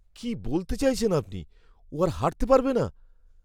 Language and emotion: Bengali, fearful